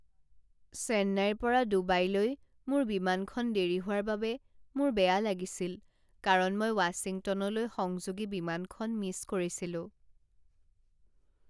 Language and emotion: Assamese, sad